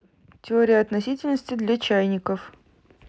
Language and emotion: Russian, neutral